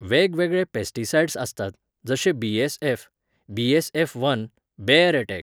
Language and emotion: Goan Konkani, neutral